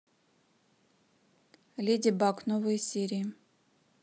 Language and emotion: Russian, neutral